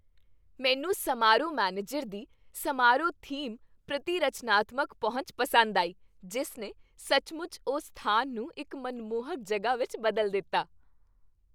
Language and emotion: Punjabi, happy